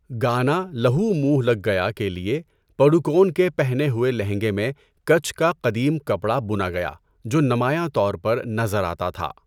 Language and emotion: Urdu, neutral